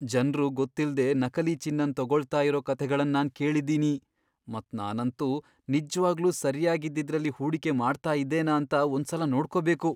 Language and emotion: Kannada, fearful